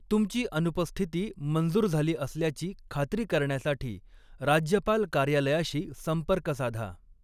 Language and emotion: Marathi, neutral